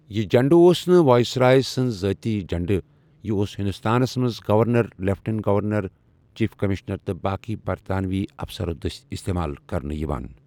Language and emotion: Kashmiri, neutral